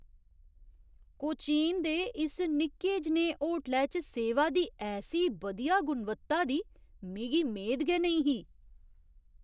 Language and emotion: Dogri, surprised